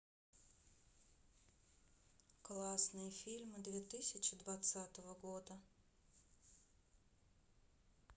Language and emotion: Russian, neutral